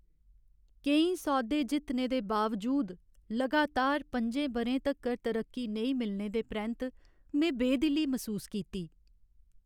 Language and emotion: Dogri, sad